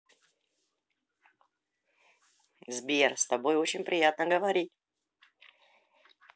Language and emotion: Russian, positive